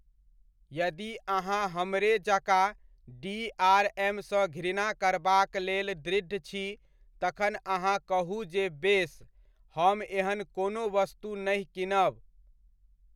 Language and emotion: Maithili, neutral